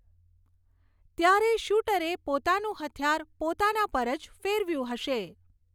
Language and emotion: Gujarati, neutral